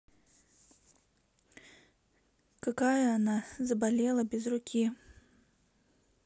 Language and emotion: Russian, sad